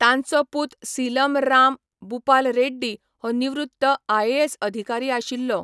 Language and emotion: Goan Konkani, neutral